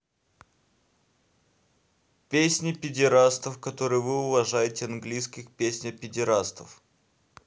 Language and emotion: Russian, neutral